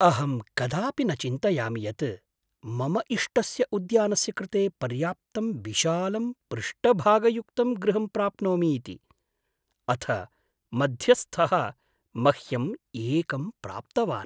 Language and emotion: Sanskrit, surprised